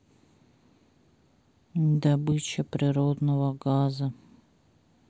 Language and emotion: Russian, sad